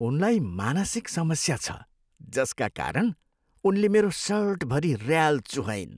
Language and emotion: Nepali, disgusted